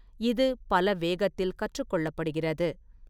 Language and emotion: Tamil, neutral